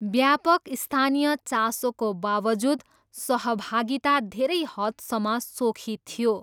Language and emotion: Nepali, neutral